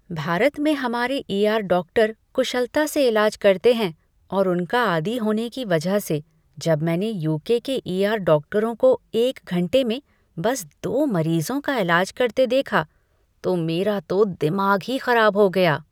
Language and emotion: Hindi, disgusted